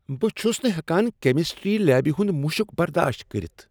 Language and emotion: Kashmiri, disgusted